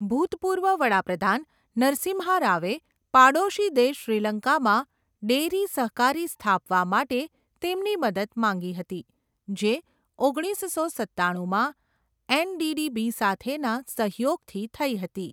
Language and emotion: Gujarati, neutral